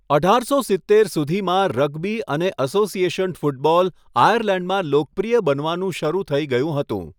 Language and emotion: Gujarati, neutral